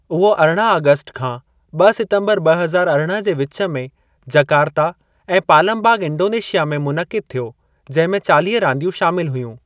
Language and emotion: Sindhi, neutral